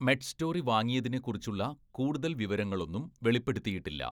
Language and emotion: Malayalam, neutral